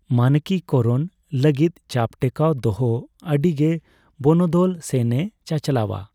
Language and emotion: Santali, neutral